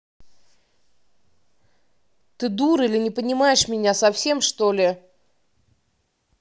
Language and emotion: Russian, angry